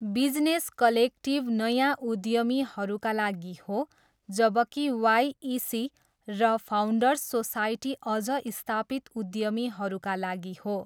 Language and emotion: Nepali, neutral